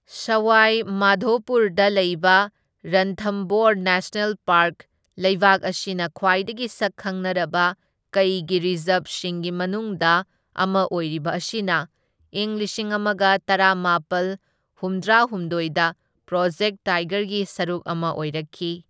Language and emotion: Manipuri, neutral